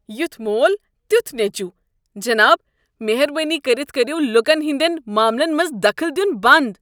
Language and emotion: Kashmiri, disgusted